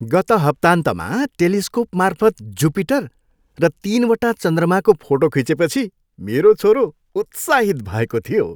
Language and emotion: Nepali, happy